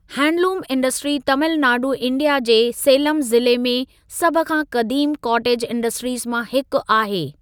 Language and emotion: Sindhi, neutral